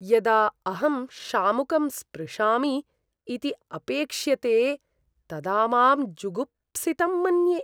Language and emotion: Sanskrit, disgusted